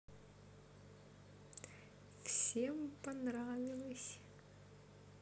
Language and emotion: Russian, positive